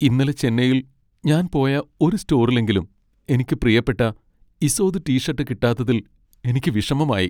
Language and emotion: Malayalam, sad